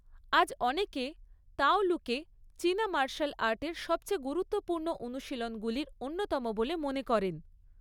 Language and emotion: Bengali, neutral